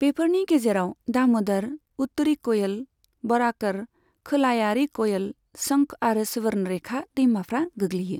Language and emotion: Bodo, neutral